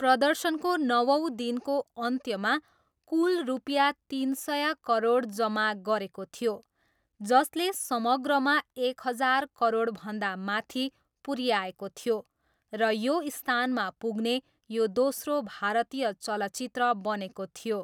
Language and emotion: Nepali, neutral